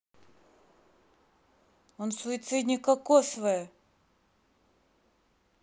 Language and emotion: Russian, angry